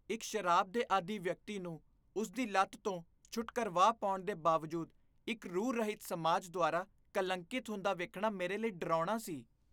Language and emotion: Punjabi, disgusted